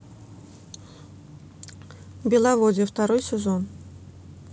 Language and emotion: Russian, neutral